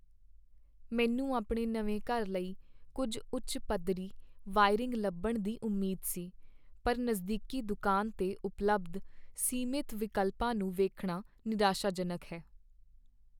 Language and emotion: Punjabi, sad